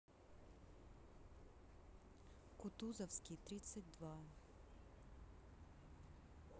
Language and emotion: Russian, neutral